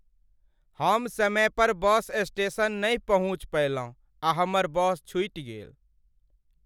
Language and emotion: Maithili, sad